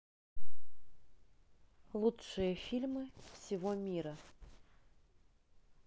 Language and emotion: Russian, neutral